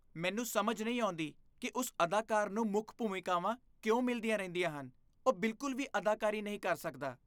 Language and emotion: Punjabi, disgusted